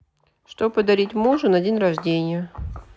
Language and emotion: Russian, neutral